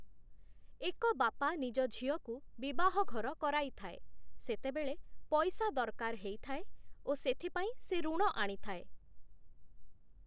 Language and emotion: Odia, neutral